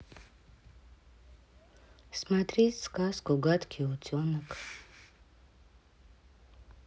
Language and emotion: Russian, sad